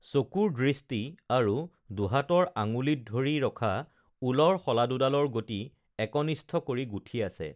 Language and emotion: Assamese, neutral